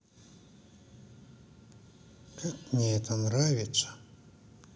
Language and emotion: Russian, neutral